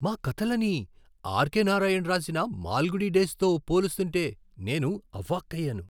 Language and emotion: Telugu, surprised